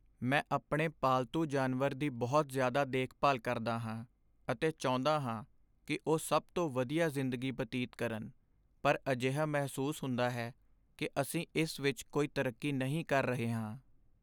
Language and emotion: Punjabi, sad